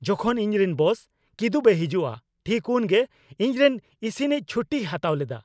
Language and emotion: Santali, angry